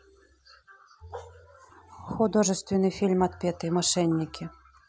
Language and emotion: Russian, neutral